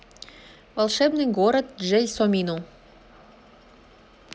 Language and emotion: Russian, neutral